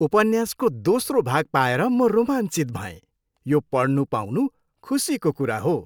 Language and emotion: Nepali, happy